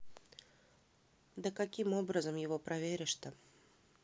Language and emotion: Russian, neutral